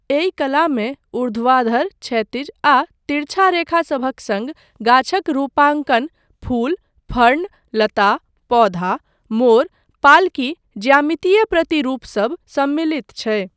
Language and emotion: Maithili, neutral